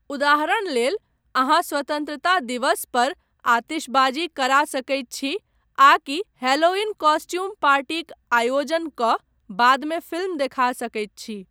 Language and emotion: Maithili, neutral